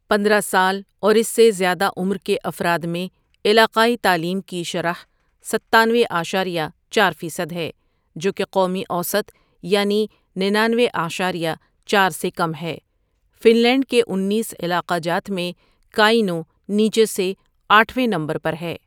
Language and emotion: Urdu, neutral